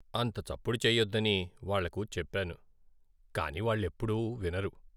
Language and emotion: Telugu, sad